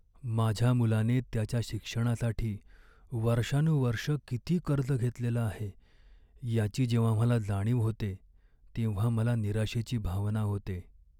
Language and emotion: Marathi, sad